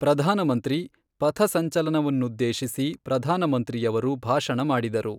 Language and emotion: Kannada, neutral